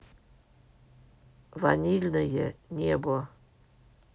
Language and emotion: Russian, neutral